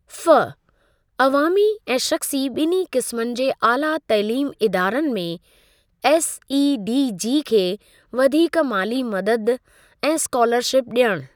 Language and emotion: Sindhi, neutral